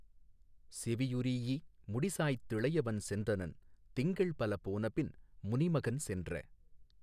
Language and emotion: Tamil, neutral